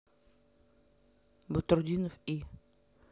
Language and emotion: Russian, neutral